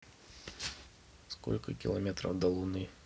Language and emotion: Russian, neutral